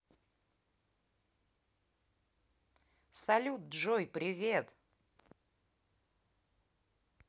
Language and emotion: Russian, positive